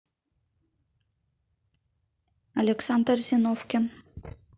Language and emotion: Russian, neutral